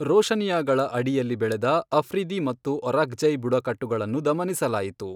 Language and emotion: Kannada, neutral